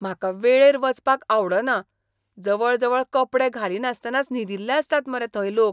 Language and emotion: Goan Konkani, disgusted